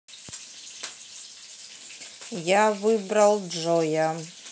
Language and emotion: Russian, neutral